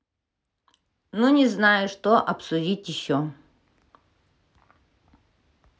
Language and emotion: Russian, neutral